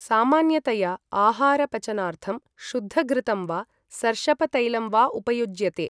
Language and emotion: Sanskrit, neutral